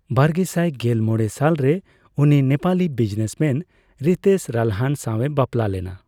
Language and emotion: Santali, neutral